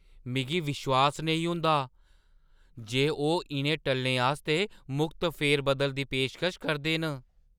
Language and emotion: Dogri, surprised